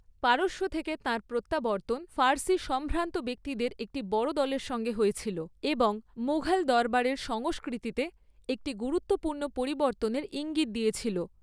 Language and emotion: Bengali, neutral